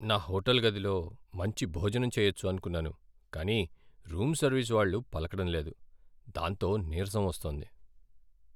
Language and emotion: Telugu, sad